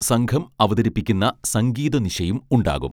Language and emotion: Malayalam, neutral